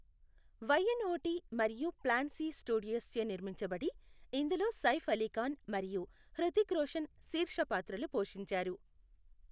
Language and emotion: Telugu, neutral